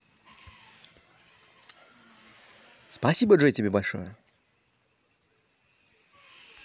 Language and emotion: Russian, positive